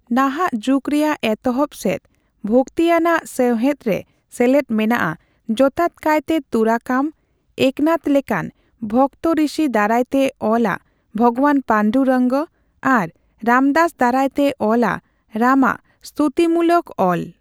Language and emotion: Santali, neutral